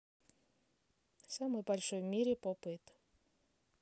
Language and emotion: Russian, neutral